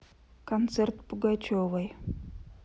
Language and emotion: Russian, neutral